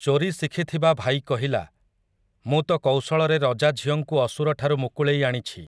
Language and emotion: Odia, neutral